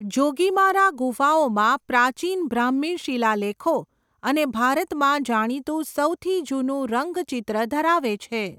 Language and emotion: Gujarati, neutral